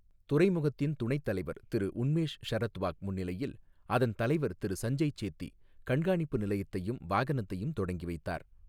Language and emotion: Tamil, neutral